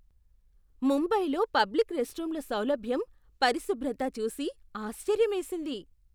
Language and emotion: Telugu, surprised